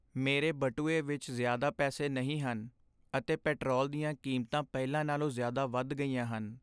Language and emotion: Punjabi, sad